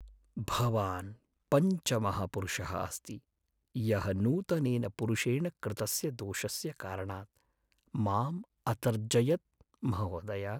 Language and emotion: Sanskrit, sad